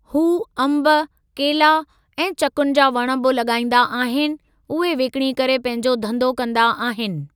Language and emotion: Sindhi, neutral